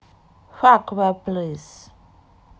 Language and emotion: Russian, neutral